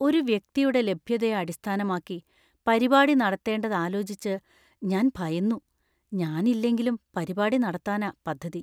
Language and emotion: Malayalam, fearful